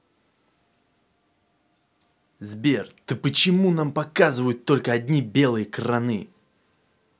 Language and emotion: Russian, angry